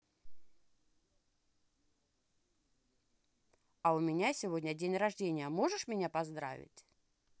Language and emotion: Russian, positive